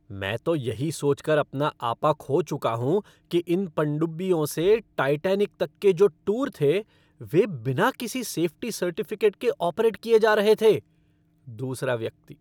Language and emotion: Hindi, angry